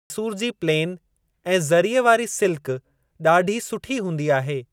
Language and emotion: Sindhi, neutral